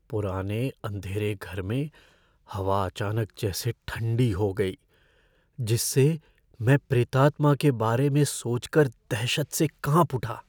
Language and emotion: Hindi, fearful